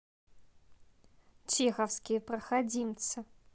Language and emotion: Russian, neutral